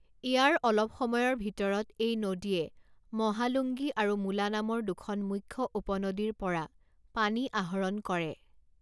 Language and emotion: Assamese, neutral